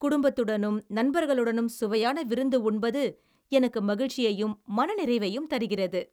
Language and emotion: Tamil, happy